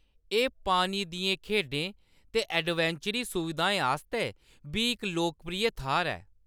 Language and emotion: Dogri, neutral